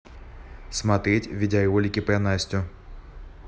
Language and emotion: Russian, neutral